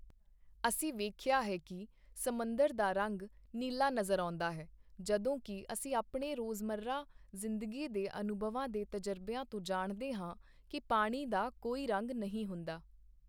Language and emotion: Punjabi, neutral